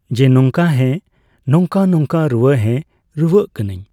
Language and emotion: Santali, neutral